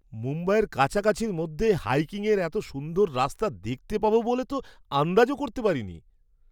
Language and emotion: Bengali, surprised